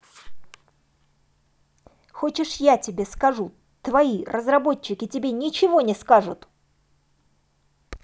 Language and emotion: Russian, angry